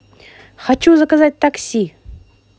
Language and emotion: Russian, positive